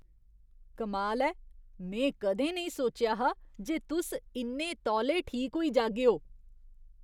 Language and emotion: Dogri, surprised